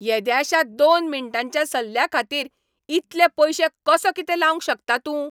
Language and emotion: Goan Konkani, angry